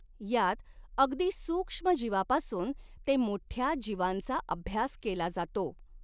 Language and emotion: Marathi, neutral